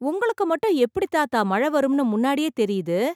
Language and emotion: Tamil, surprised